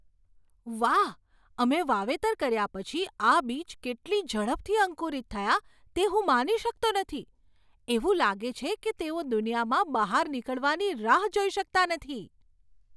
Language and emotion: Gujarati, surprised